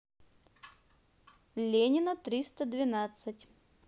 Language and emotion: Russian, neutral